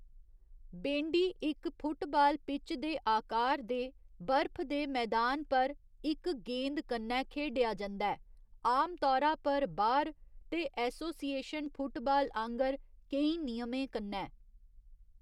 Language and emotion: Dogri, neutral